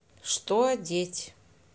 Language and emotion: Russian, neutral